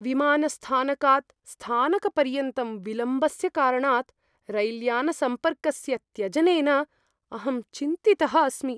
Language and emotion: Sanskrit, fearful